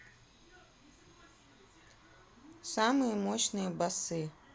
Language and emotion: Russian, neutral